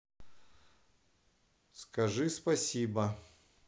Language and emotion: Russian, neutral